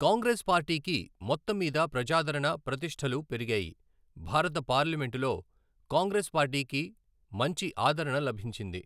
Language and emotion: Telugu, neutral